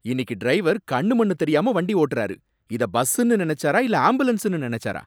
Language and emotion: Tamil, angry